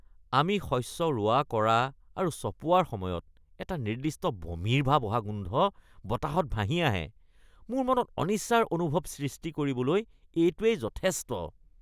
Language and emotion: Assamese, disgusted